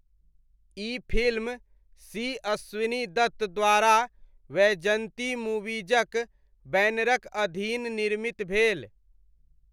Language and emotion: Maithili, neutral